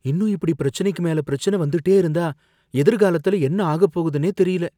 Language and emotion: Tamil, fearful